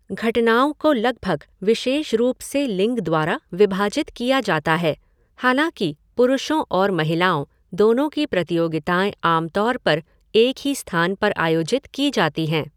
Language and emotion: Hindi, neutral